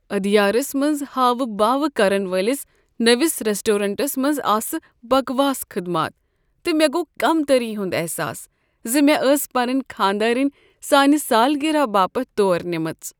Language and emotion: Kashmiri, sad